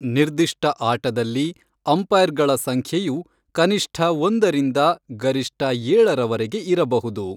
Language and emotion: Kannada, neutral